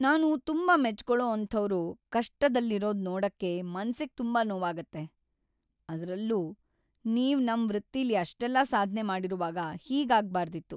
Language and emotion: Kannada, sad